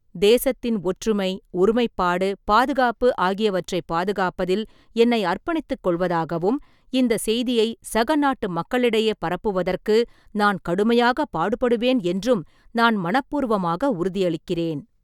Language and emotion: Tamil, neutral